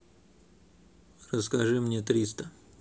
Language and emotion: Russian, neutral